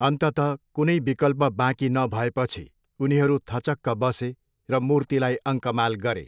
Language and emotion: Nepali, neutral